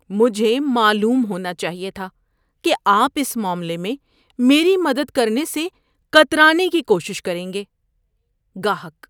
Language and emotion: Urdu, disgusted